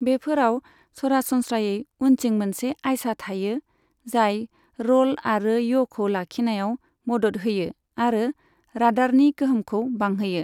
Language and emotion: Bodo, neutral